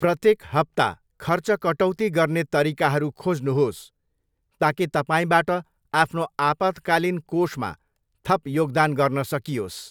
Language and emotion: Nepali, neutral